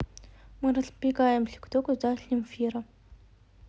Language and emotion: Russian, neutral